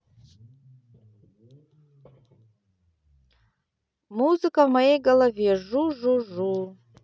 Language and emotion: Russian, neutral